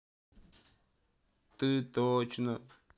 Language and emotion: Russian, sad